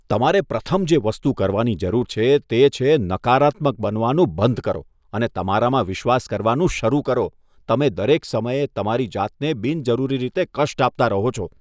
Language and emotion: Gujarati, disgusted